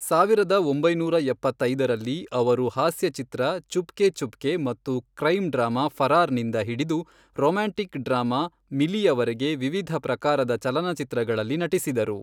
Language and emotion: Kannada, neutral